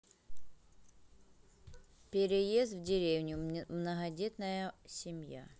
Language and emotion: Russian, neutral